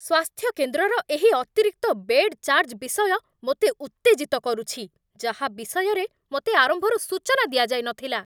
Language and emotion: Odia, angry